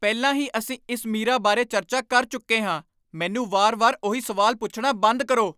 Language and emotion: Punjabi, angry